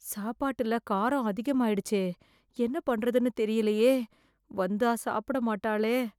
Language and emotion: Tamil, fearful